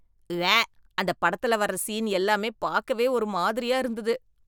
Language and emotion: Tamil, disgusted